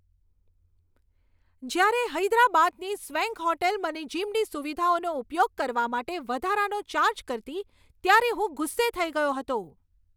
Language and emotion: Gujarati, angry